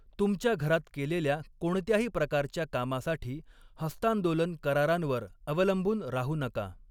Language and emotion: Marathi, neutral